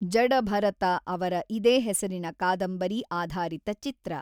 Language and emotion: Kannada, neutral